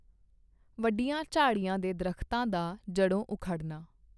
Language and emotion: Punjabi, neutral